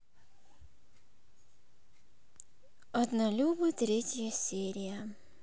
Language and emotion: Russian, sad